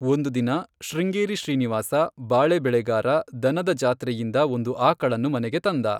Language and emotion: Kannada, neutral